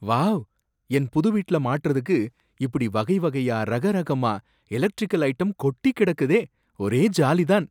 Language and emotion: Tamil, surprised